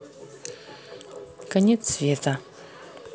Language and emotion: Russian, neutral